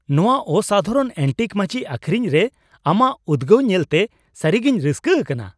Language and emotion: Santali, surprised